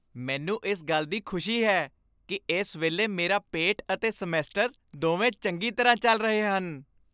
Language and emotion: Punjabi, happy